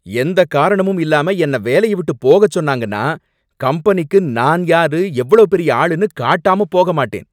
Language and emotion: Tamil, angry